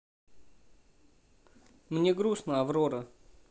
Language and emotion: Russian, neutral